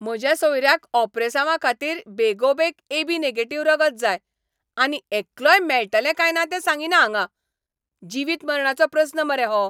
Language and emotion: Goan Konkani, angry